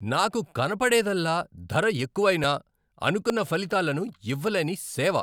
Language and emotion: Telugu, angry